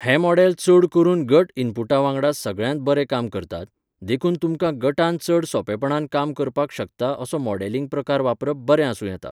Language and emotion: Goan Konkani, neutral